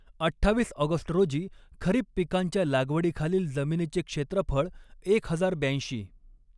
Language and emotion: Marathi, neutral